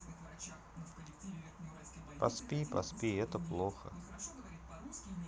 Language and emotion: Russian, sad